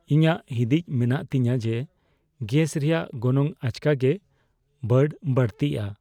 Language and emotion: Santali, fearful